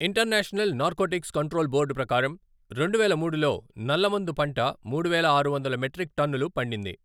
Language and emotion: Telugu, neutral